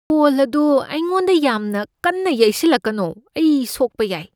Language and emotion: Manipuri, fearful